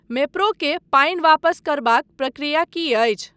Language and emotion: Maithili, neutral